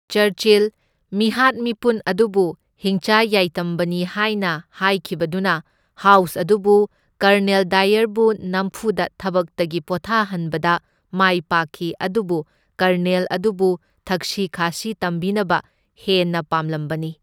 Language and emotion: Manipuri, neutral